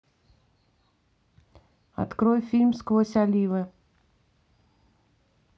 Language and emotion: Russian, neutral